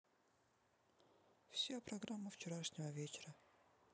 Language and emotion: Russian, neutral